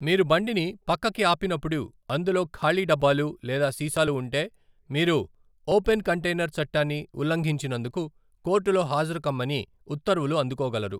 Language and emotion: Telugu, neutral